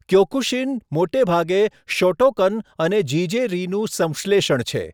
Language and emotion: Gujarati, neutral